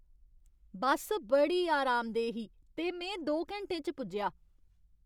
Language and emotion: Dogri, happy